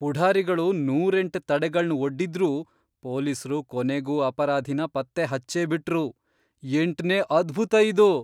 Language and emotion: Kannada, surprised